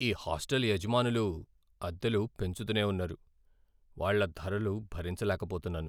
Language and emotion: Telugu, sad